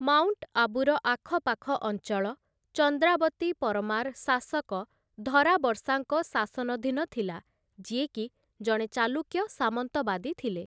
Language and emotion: Odia, neutral